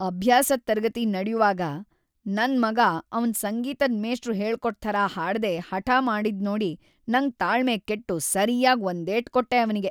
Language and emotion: Kannada, angry